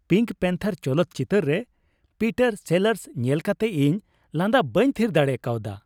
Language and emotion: Santali, happy